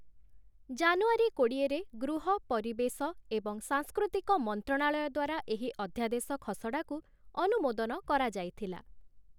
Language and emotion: Odia, neutral